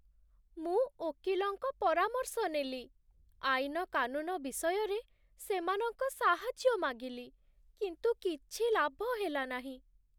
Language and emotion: Odia, sad